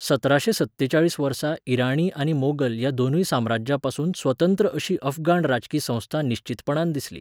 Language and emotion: Goan Konkani, neutral